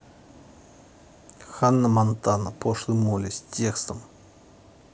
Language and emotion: Russian, neutral